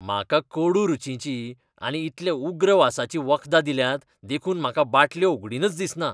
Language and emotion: Goan Konkani, disgusted